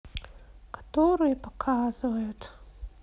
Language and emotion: Russian, sad